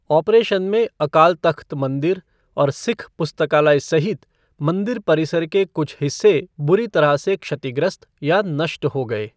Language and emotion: Hindi, neutral